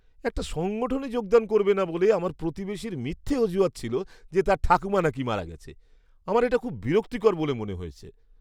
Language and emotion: Bengali, disgusted